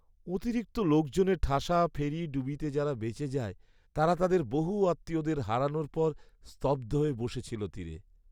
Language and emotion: Bengali, sad